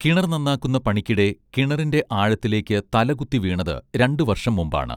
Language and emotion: Malayalam, neutral